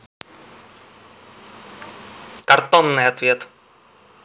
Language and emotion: Russian, neutral